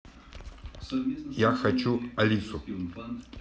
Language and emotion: Russian, neutral